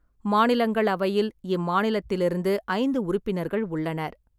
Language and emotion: Tamil, neutral